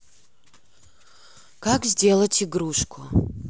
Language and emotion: Russian, neutral